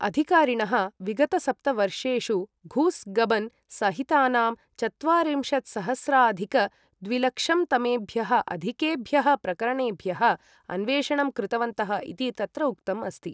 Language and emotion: Sanskrit, neutral